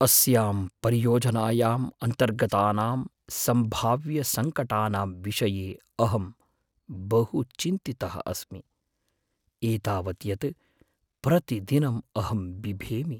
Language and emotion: Sanskrit, fearful